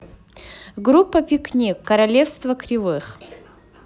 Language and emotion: Russian, positive